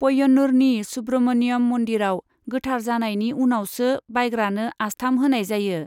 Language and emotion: Bodo, neutral